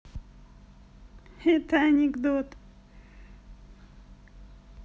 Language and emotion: Russian, positive